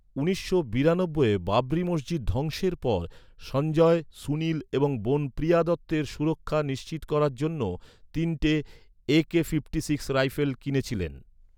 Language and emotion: Bengali, neutral